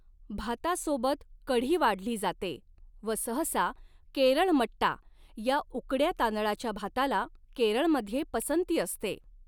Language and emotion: Marathi, neutral